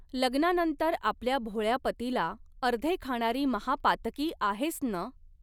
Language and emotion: Marathi, neutral